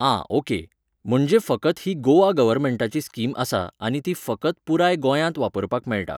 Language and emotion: Goan Konkani, neutral